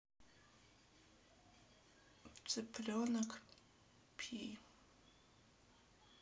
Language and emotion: Russian, sad